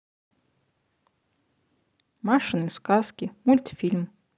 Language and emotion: Russian, neutral